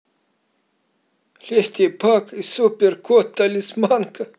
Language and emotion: Russian, positive